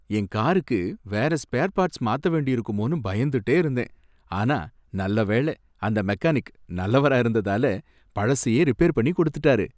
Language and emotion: Tamil, happy